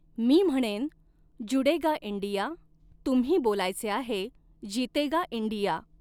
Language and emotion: Marathi, neutral